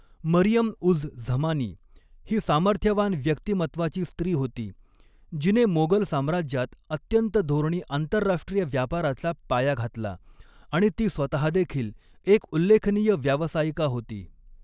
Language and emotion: Marathi, neutral